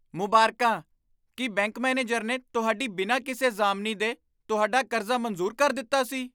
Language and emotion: Punjabi, surprised